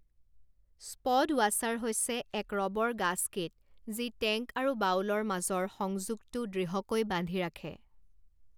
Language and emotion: Assamese, neutral